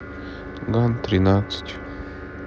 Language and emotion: Russian, sad